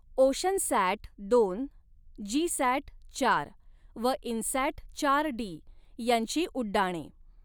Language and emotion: Marathi, neutral